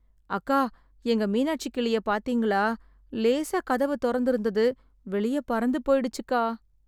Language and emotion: Tamil, sad